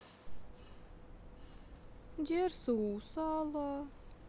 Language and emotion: Russian, sad